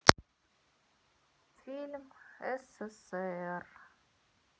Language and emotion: Russian, sad